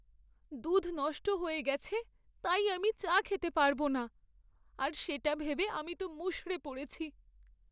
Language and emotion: Bengali, sad